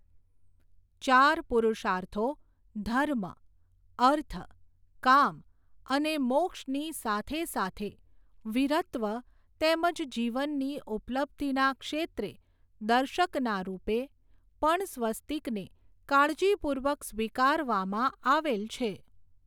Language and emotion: Gujarati, neutral